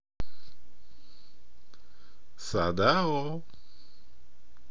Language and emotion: Russian, positive